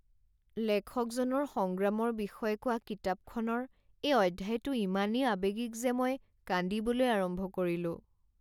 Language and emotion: Assamese, sad